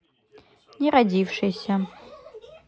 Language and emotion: Russian, neutral